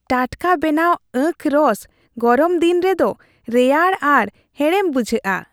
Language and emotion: Santali, happy